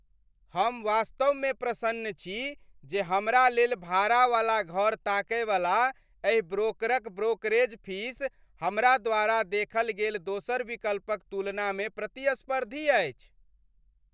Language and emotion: Maithili, happy